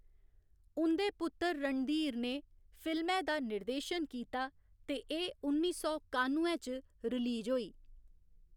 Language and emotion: Dogri, neutral